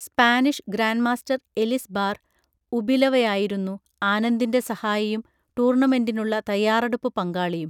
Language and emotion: Malayalam, neutral